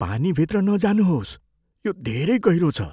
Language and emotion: Nepali, fearful